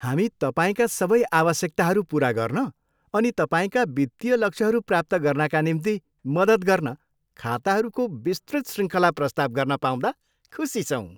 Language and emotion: Nepali, happy